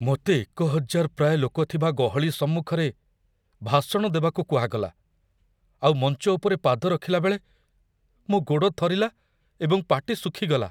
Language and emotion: Odia, fearful